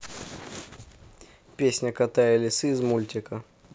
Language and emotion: Russian, neutral